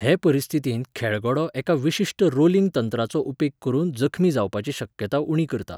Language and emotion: Goan Konkani, neutral